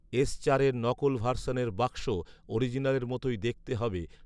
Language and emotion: Bengali, neutral